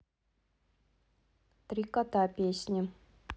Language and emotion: Russian, neutral